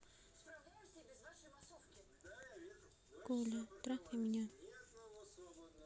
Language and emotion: Russian, neutral